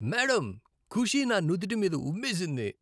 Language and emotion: Telugu, disgusted